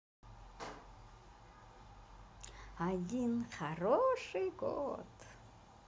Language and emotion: Russian, positive